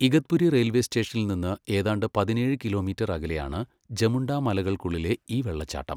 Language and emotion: Malayalam, neutral